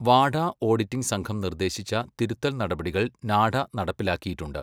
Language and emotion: Malayalam, neutral